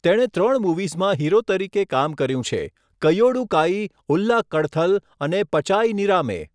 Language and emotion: Gujarati, neutral